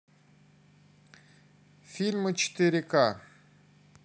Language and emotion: Russian, neutral